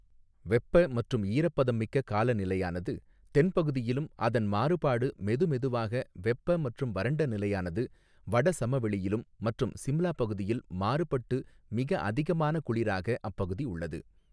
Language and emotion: Tamil, neutral